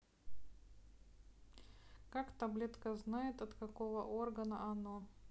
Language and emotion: Russian, neutral